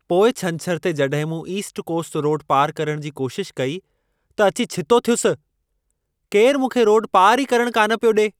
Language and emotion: Sindhi, angry